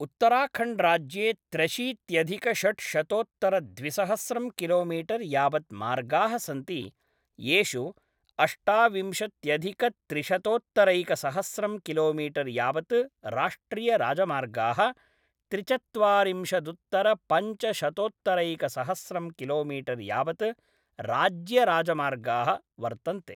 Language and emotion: Sanskrit, neutral